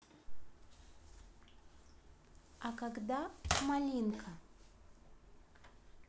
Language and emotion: Russian, neutral